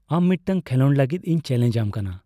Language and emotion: Santali, neutral